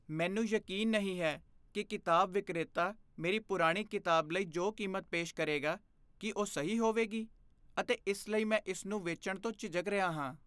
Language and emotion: Punjabi, fearful